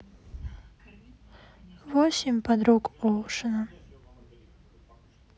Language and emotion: Russian, sad